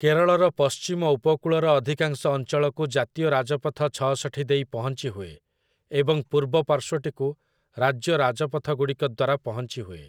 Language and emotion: Odia, neutral